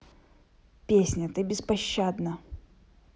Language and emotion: Russian, neutral